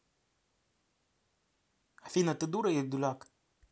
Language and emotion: Russian, angry